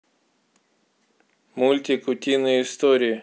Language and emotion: Russian, neutral